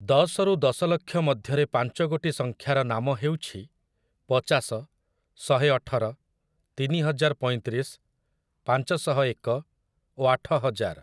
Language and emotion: Odia, neutral